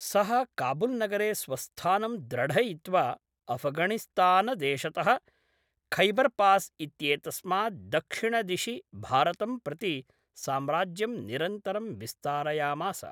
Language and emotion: Sanskrit, neutral